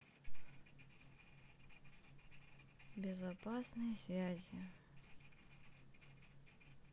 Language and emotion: Russian, sad